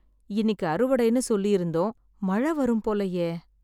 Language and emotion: Tamil, sad